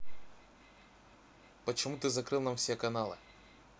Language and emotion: Russian, neutral